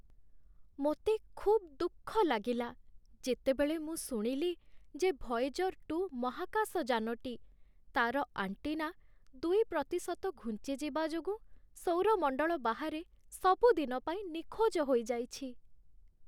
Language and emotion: Odia, sad